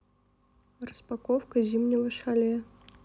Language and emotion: Russian, neutral